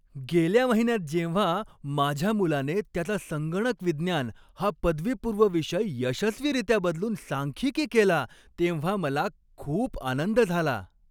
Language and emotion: Marathi, happy